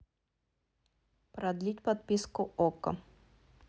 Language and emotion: Russian, neutral